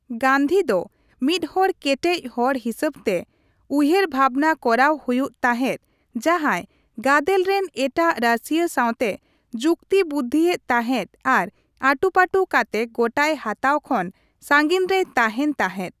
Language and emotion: Santali, neutral